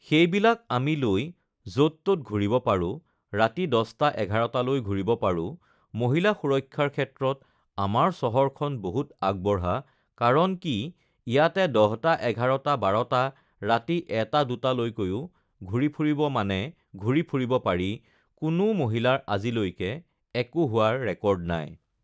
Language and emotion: Assamese, neutral